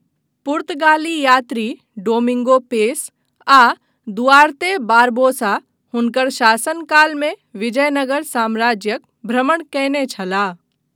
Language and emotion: Maithili, neutral